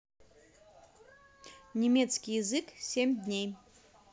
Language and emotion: Russian, neutral